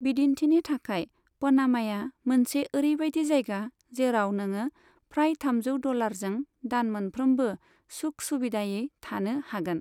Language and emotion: Bodo, neutral